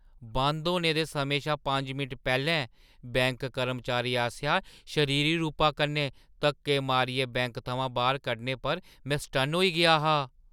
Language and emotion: Dogri, surprised